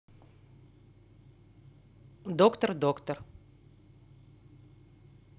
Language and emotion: Russian, neutral